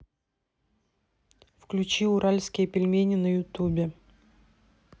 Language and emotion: Russian, neutral